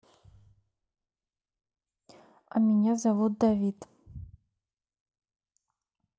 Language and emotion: Russian, neutral